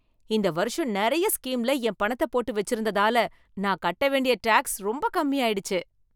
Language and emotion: Tamil, happy